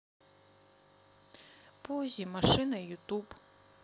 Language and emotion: Russian, sad